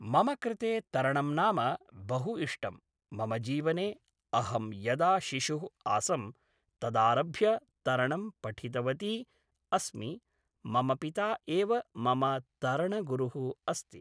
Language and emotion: Sanskrit, neutral